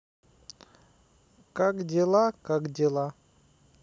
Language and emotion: Russian, sad